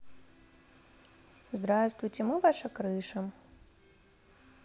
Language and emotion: Russian, neutral